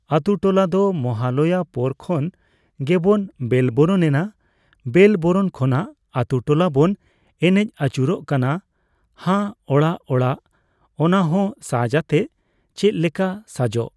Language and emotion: Santali, neutral